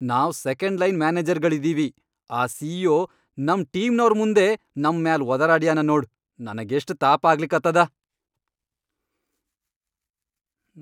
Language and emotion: Kannada, angry